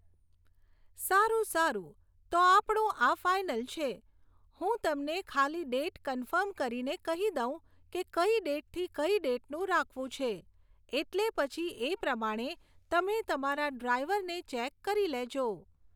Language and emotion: Gujarati, neutral